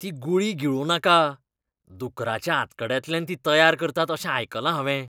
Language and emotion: Goan Konkani, disgusted